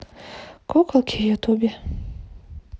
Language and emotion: Russian, neutral